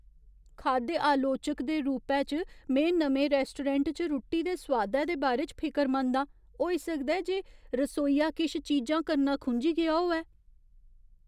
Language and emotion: Dogri, fearful